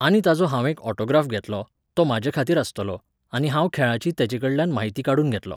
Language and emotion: Goan Konkani, neutral